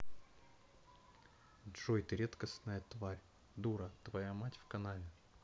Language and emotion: Russian, neutral